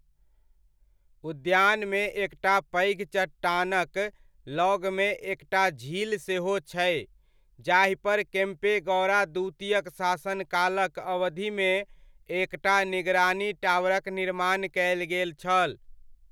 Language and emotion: Maithili, neutral